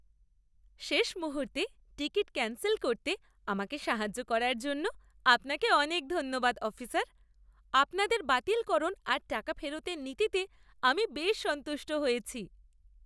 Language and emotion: Bengali, happy